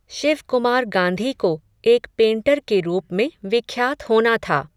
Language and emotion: Hindi, neutral